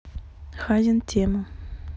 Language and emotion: Russian, neutral